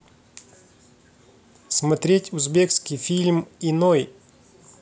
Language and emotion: Russian, neutral